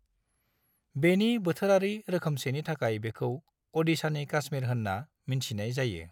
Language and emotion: Bodo, neutral